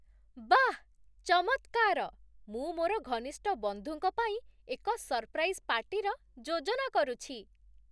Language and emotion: Odia, surprised